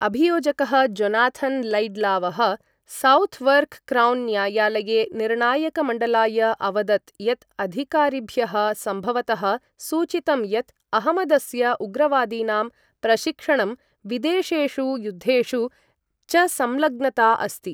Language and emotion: Sanskrit, neutral